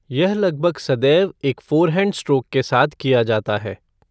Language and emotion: Hindi, neutral